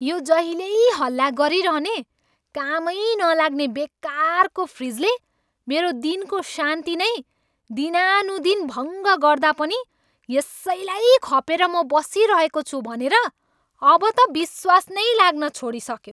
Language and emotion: Nepali, angry